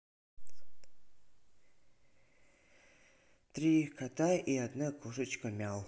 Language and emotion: Russian, neutral